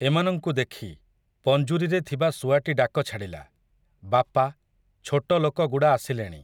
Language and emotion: Odia, neutral